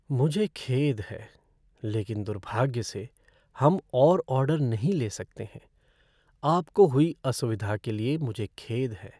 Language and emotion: Hindi, sad